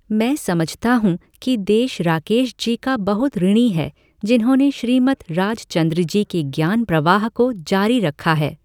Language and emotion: Hindi, neutral